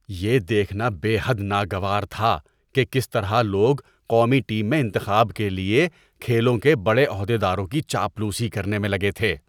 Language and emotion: Urdu, disgusted